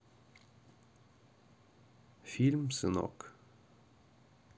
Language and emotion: Russian, neutral